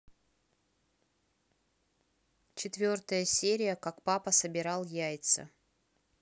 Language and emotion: Russian, neutral